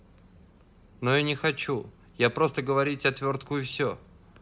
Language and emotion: Russian, neutral